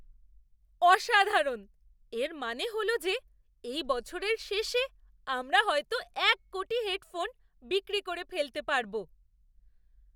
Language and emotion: Bengali, surprised